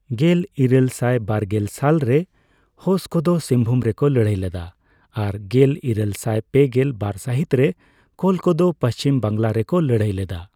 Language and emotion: Santali, neutral